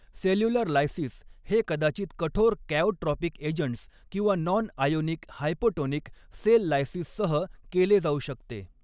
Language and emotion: Marathi, neutral